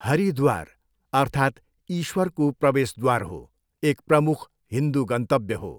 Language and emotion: Nepali, neutral